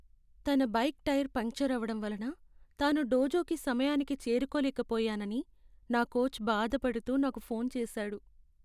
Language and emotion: Telugu, sad